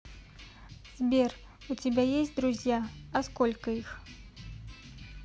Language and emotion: Russian, neutral